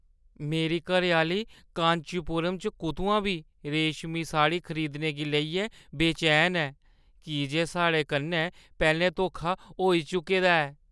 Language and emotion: Dogri, fearful